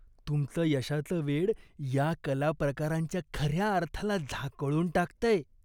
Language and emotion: Marathi, disgusted